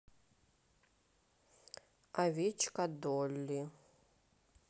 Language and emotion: Russian, neutral